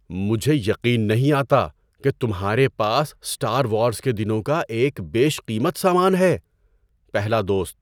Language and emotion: Urdu, surprised